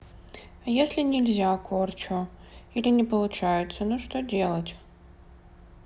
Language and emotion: Russian, sad